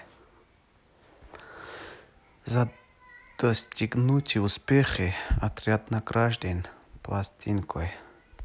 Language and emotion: Russian, neutral